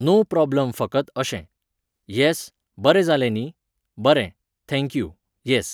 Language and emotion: Goan Konkani, neutral